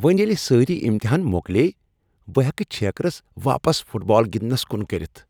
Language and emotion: Kashmiri, happy